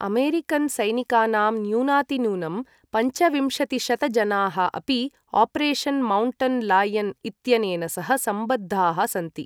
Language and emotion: Sanskrit, neutral